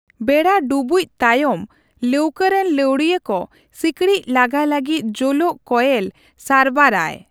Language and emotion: Santali, neutral